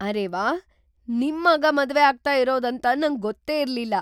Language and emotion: Kannada, surprised